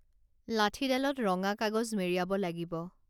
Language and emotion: Assamese, neutral